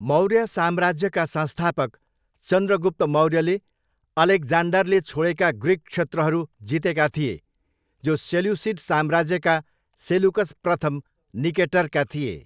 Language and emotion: Nepali, neutral